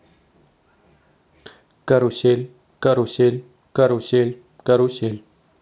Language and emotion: Russian, neutral